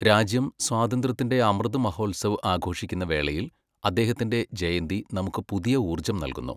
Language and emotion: Malayalam, neutral